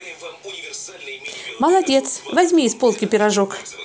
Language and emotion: Russian, positive